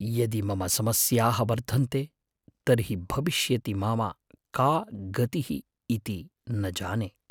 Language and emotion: Sanskrit, fearful